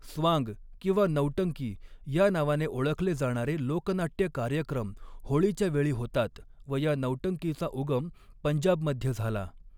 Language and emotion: Marathi, neutral